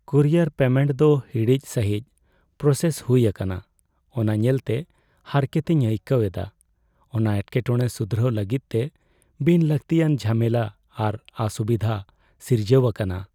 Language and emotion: Santali, sad